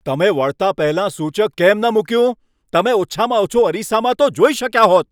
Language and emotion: Gujarati, angry